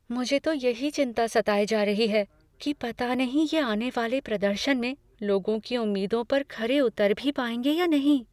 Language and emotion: Hindi, fearful